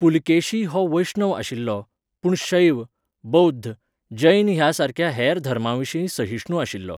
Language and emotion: Goan Konkani, neutral